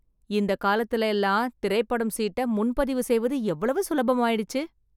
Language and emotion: Tamil, surprised